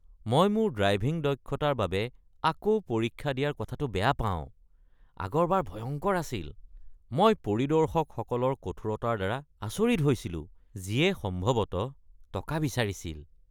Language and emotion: Assamese, disgusted